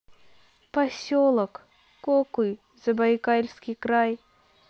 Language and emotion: Russian, neutral